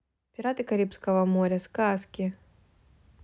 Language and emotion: Russian, neutral